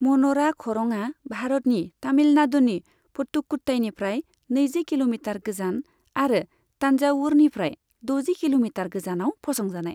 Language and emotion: Bodo, neutral